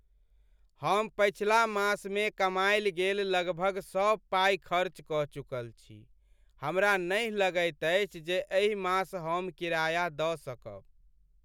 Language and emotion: Maithili, sad